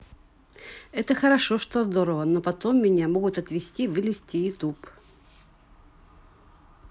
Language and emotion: Russian, neutral